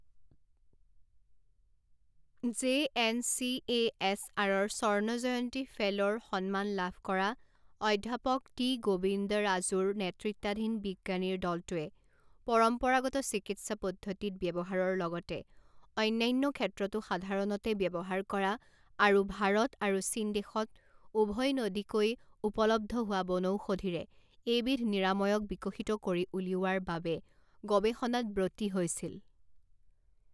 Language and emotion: Assamese, neutral